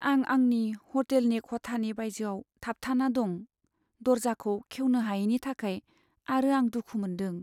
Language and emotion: Bodo, sad